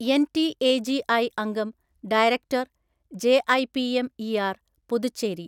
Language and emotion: Malayalam, neutral